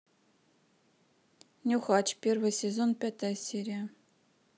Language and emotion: Russian, neutral